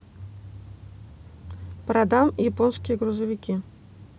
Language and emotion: Russian, neutral